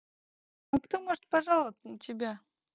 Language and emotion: Russian, neutral